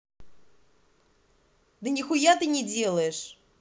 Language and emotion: Russian, angry